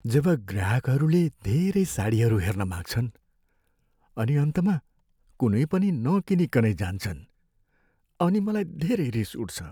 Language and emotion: Nepali, sad